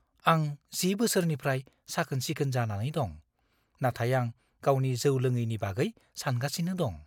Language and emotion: Bodo, fearful